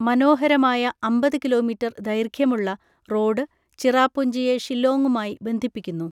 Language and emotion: Malayalam, neutral